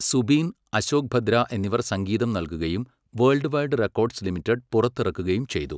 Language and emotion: Malayalam, neutral